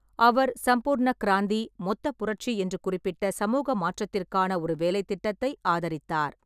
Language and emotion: Tamil, neutral